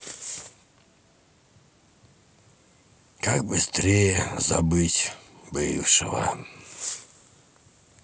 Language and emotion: Russian, sad